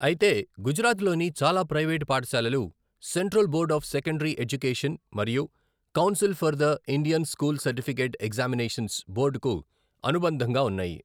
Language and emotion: Telugu, neutral